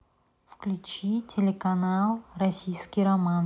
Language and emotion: Russian, neutral